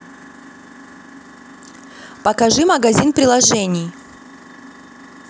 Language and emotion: Russian, neutral